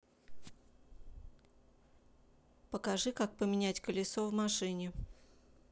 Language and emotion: Russian, neutral